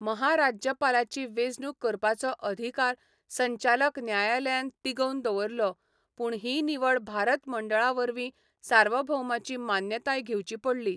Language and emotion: Goan Konkani, neutral